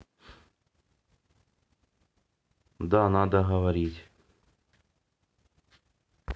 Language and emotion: Russian, neutral